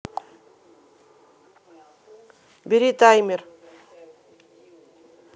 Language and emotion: Russian, angry